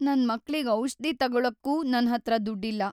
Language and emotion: Kannada, sad